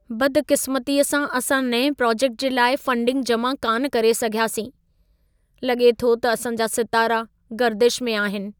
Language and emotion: Sindhi, sad